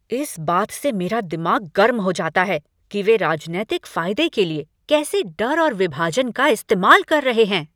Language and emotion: Hindi, angry